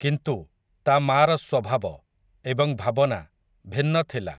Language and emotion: Odia, neutral